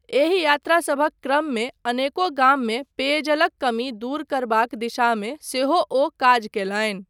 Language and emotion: Maithili, neutral